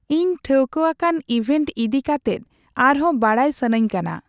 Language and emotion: Santali, neutral